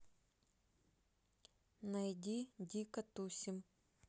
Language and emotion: Russian, neutral